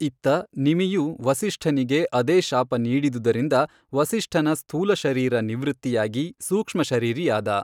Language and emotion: Kannada, neutral